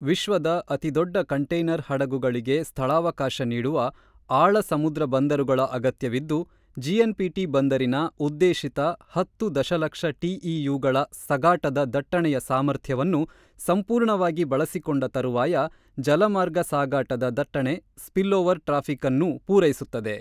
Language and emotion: Kannada, neutral